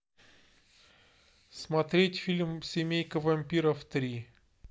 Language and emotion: Russian, neutral